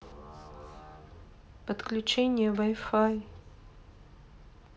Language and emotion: Russian, sad